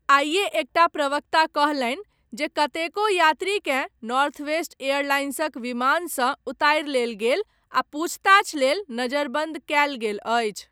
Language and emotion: Maithili, neutral